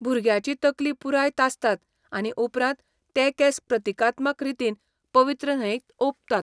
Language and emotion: Goan Konkani, neutral